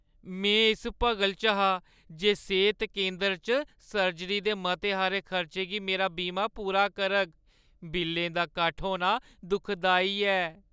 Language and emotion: Dogri, sad